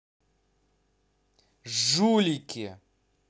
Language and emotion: Russian, angry